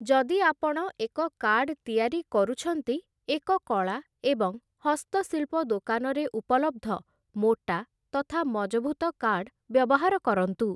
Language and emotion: Odia, neutral